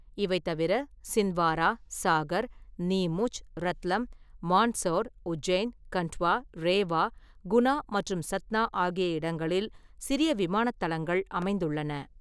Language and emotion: Tamil, neutral